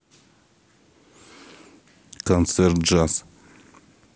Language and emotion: Russian, neutral